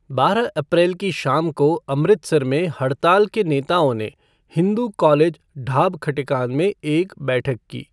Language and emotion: Hindi, neutral